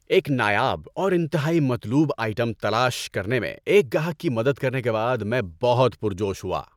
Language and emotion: Urdu, happy